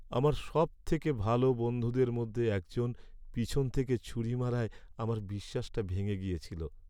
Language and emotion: Bengali, sad